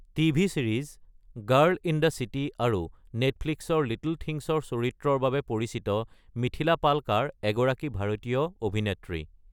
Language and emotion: Assamese, neutral